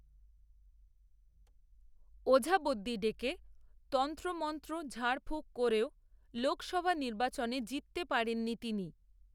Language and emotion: Bengali, neutral